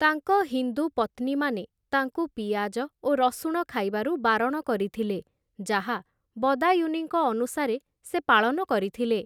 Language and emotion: Odia, neutral